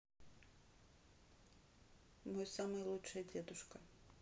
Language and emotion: Russian, neutral